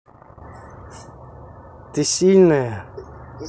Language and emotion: Russian, neutral